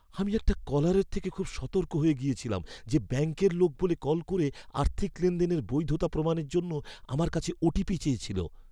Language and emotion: Bengali, fearful